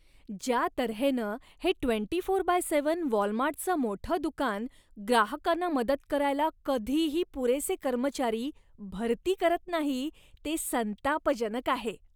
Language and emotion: Marathi, disgusted